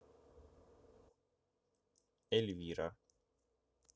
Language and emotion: Russian, neutral